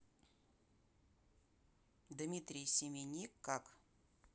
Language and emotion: Russian, neutral